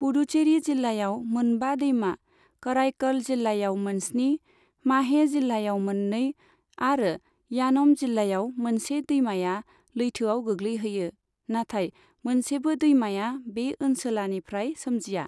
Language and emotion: Bodo, neutral